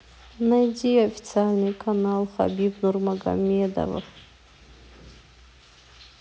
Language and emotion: Russian, sad